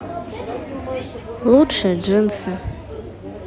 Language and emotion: Russian, sad